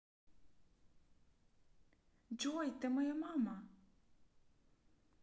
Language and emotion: Russian, neutral